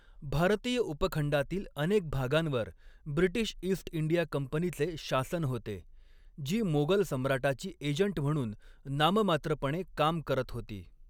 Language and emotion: Marathi, neutral